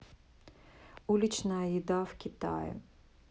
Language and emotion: Russian, neutral